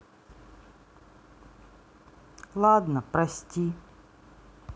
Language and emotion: Russian, sad